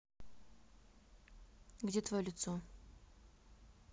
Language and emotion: Russian, neutral